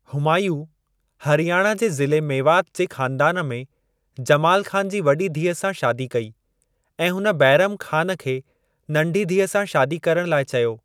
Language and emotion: Sindhi, neutral